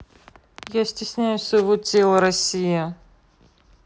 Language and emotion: Russian, neutral